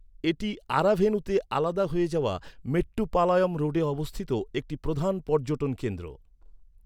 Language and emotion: Bengali, neutral